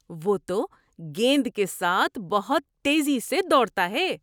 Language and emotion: Urdu, surprised